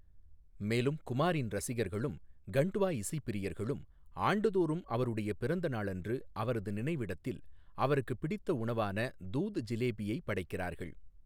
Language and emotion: Tamil, neutral